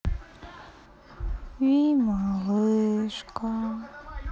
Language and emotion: Russian, sad